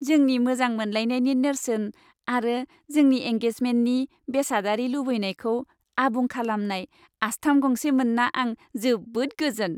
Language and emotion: Bodo, happy